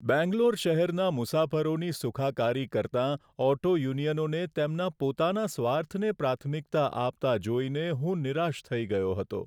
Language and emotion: Gujarati, sad